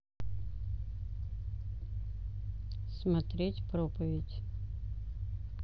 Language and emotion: Russian, neutral